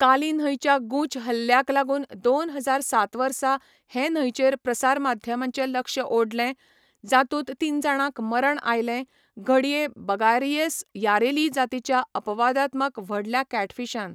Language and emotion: Goan Konkani, neutral